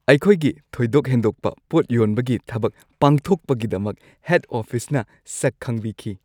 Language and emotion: Manipuri, happy